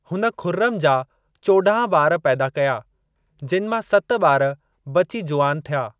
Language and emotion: Sindhi, neutral